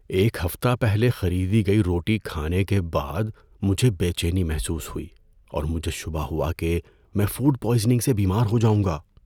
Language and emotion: Urdu, fearful